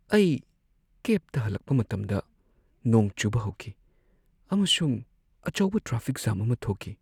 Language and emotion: Manipuri, sad